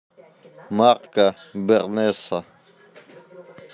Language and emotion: Russian, neutral